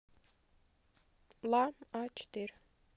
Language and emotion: Russian, neutral